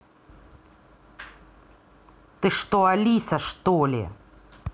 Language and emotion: Russian, angry